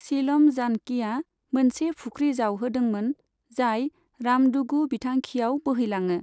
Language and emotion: Bodo, neutral